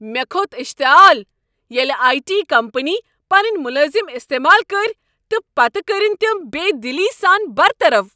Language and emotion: Kashmiri, angry